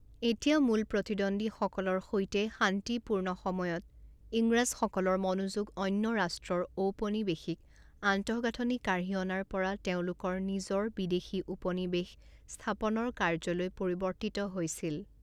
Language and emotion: Assamese, neutral